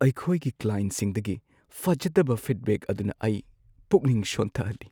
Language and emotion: Manipuri, sad